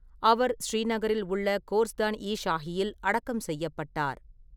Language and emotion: Tamil, neutral